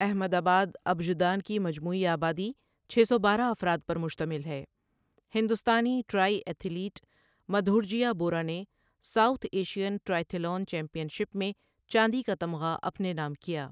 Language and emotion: Urdu, neutral